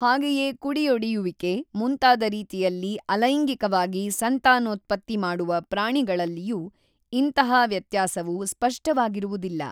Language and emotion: Kannada, neutral